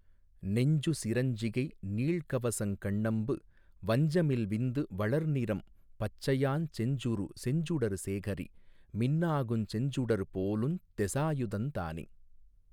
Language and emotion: Tamil, neutral